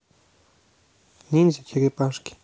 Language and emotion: Russian, neutral